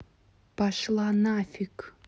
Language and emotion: Russian, angry